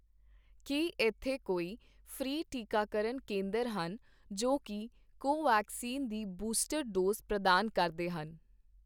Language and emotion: Punjabi, neutral